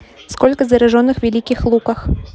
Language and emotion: Russian, neutral